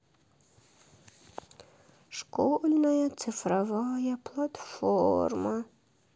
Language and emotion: Russian, sad